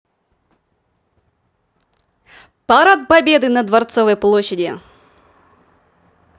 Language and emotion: Russian, positive